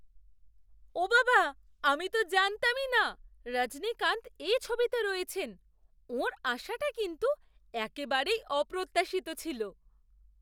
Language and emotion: Bengali, surprised